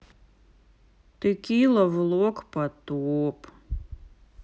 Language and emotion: Russian, sad